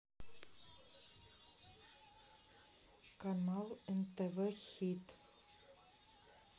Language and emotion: Russian, neutral